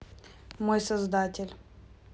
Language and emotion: Russian, neutral